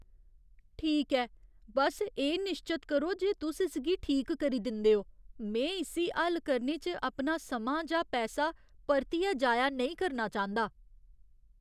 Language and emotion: Dogri, fearful